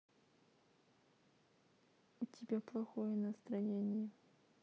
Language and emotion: Russian, sad